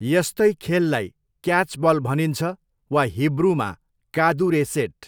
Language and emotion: Nepali, neutral